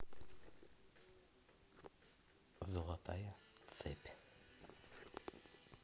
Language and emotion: Russian, neutral